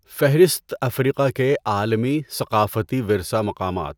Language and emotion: Urdu, neutral